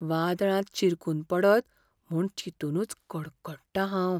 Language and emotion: Goan Konkani, fearful